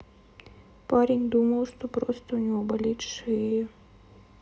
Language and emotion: Russian, sad